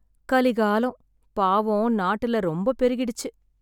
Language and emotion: Tamil, sad